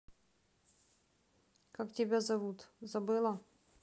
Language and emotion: Russian, neutral